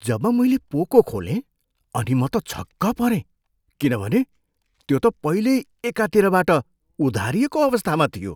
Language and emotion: Nepali, surprised